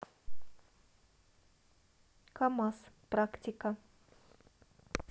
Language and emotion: Russian, neutral